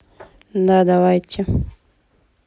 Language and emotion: Russian, neutral